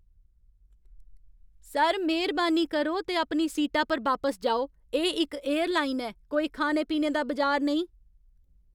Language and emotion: Dogri, angry